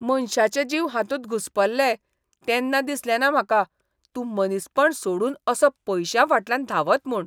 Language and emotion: Goan Konkani, disgusted